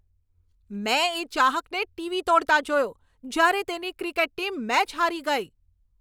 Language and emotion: Gujarati, angry